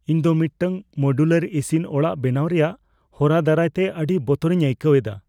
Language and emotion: Santali, fearful